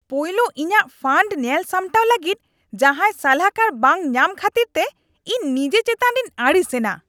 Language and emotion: Santali, angry